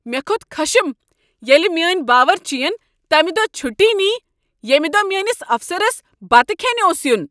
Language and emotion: Kashmiri, angry